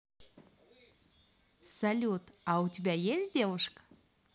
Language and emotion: Russian, positive